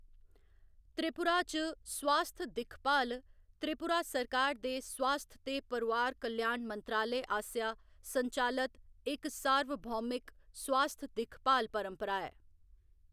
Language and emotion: Dogri, neutral